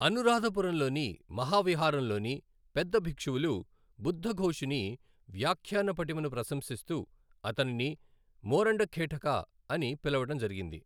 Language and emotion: Telugu, neutral